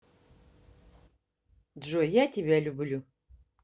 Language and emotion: Russian, neutral